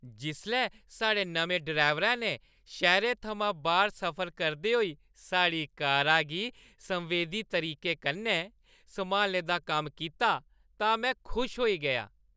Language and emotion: Dogri, happy